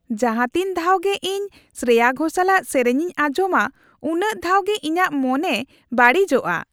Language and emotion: Santali, happy